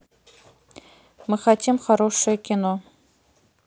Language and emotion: Russian, neutral